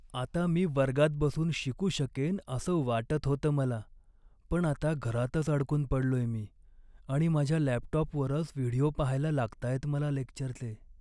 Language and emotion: Marathi, sad